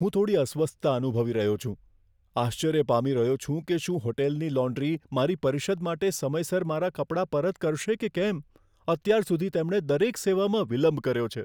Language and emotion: Gujarati, fearful